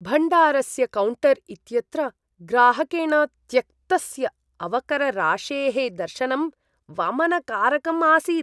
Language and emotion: Sanskrit, disgusted